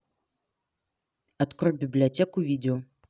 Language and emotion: Russian, neutral